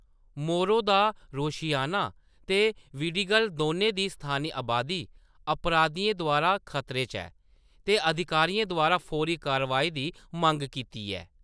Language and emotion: Dogri, neutral